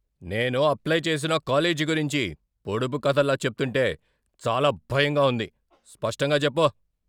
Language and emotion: Telugu, angry